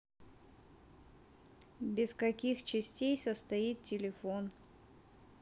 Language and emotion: Russian, neutral